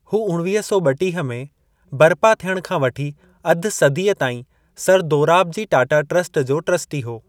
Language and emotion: Sindhi, neutral